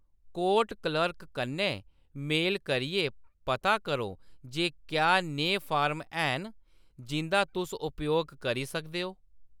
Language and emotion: Dogri, neutral